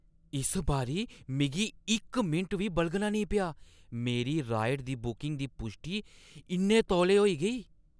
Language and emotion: Dogri, surprised